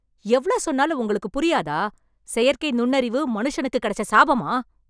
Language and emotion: Tamil, angry